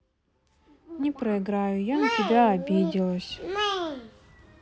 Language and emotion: Russian, sad